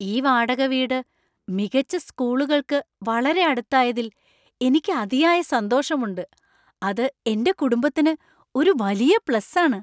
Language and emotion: Malayalam, surprised